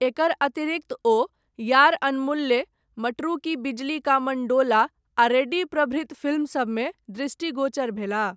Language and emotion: Maithili, neutral